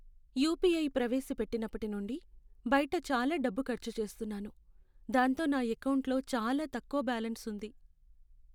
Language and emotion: Telugu, sad